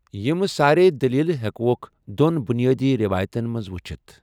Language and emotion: Kashmiri, neutral